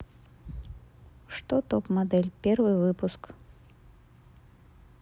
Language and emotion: Russian, neutral